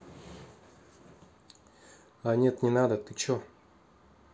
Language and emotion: Russian, neutral